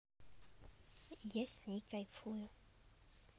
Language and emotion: Russian, neutral